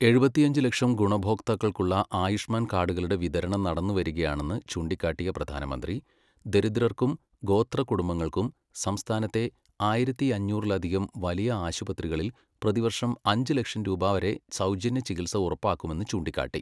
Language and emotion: Malayalam, neutral